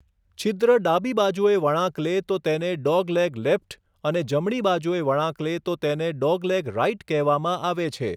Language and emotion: Gujarati, neutral